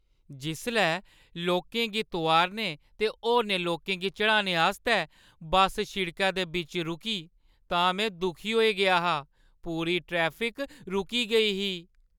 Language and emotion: Dogri, sad